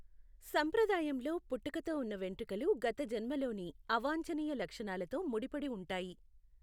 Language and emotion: Telugu, neutral